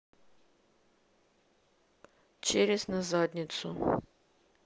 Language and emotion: Russian, neutral